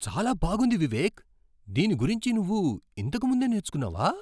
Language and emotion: Telugu, surprised